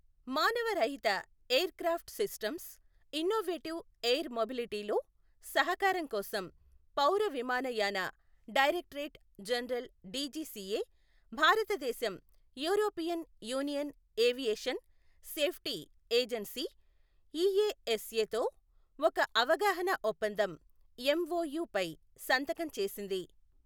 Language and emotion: Telugu, neutral